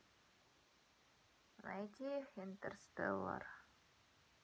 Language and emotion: Russian, sad